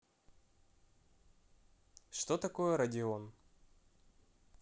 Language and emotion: Russian, neutral